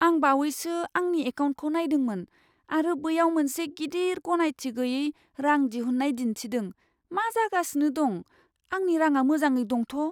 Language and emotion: Bodo, fearful